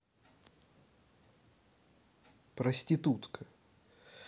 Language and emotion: Russian, neutral